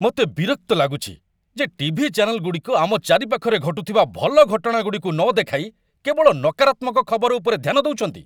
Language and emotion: Odia, angry